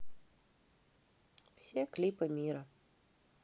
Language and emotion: Russian, neutral